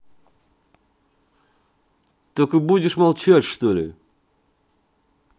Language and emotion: Russian, angry